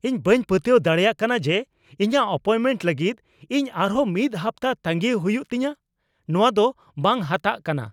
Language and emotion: Santali, angry